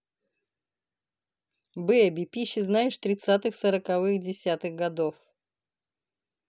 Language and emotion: Russian, neutral